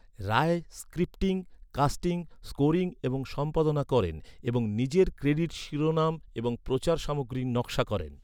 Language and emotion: Bengali, neutral